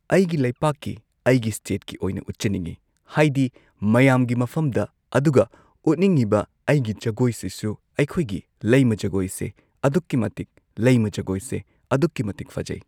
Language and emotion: Manipuri, neutral